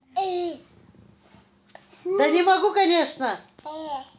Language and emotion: Russian, angry